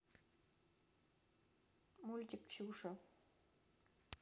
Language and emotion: Russian, neutral